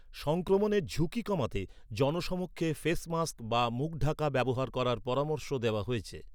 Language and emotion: Bengali, neutral